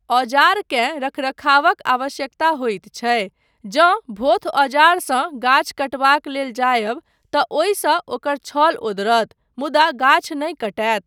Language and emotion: Maithili, neutral